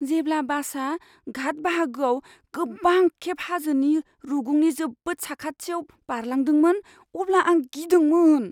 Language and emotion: Bodo, fearful